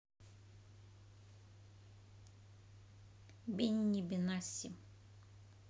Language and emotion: Russian, neutral